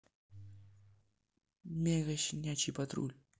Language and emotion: Russian, neutral